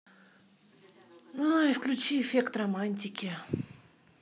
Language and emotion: Russian, sad